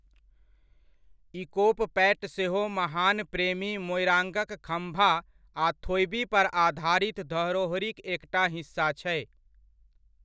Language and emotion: Maithili, neutral